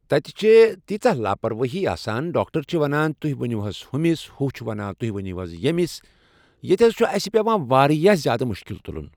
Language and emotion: Kashmiri, neutral